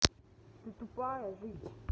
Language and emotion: Russian, angry